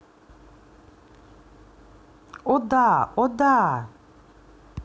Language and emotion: Russian, positive